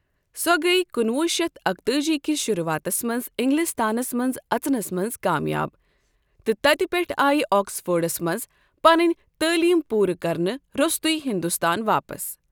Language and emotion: Kashmiri, neutral